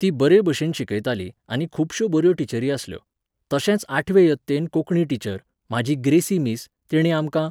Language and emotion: Goan Konkani, neutral